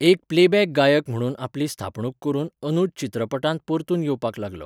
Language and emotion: Goan Konkani, neutral